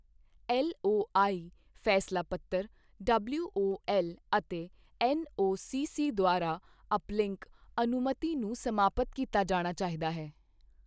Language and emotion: Punjabi, neutral